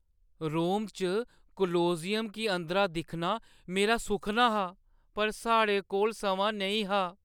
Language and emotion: Dogri, sad